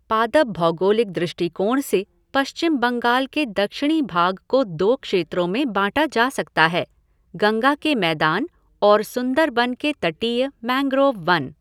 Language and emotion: Hindi, neutral